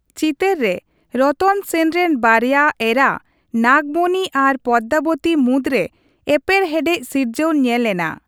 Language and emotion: Santali, neutral